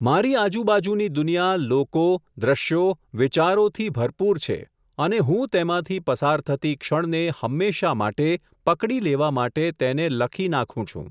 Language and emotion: Gujarati, neutral